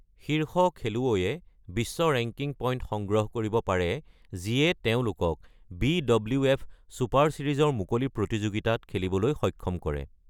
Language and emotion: Assamese, neutral